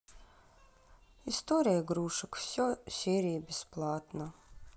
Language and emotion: Russian, sad